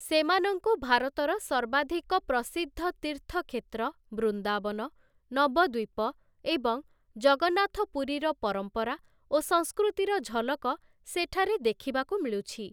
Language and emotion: Odia, neutral